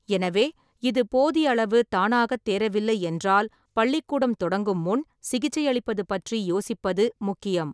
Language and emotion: Tamil, neutral